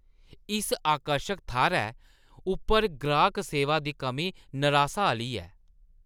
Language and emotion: Dogri, disgusted